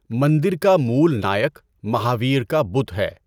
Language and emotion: Urdu, neutral